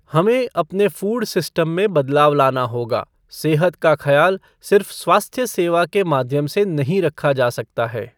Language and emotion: Hindi, neutral